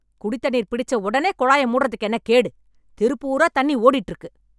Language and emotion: Tamil, angry